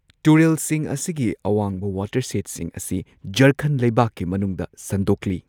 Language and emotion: Manipuri, neutral